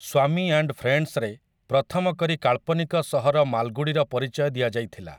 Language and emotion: Odia, neutral